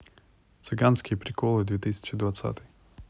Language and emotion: Russian, neutral